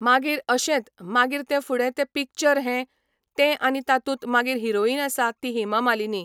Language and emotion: Goan Konkani, neutral